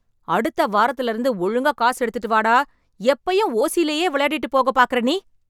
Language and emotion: Tamil, angry